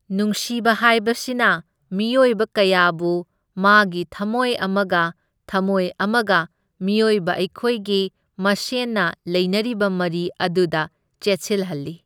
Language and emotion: Manipuri, neutral